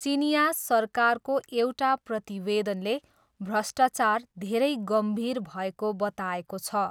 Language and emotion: Nepali, neutral